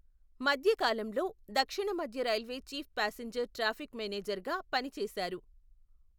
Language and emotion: Telugu, neutral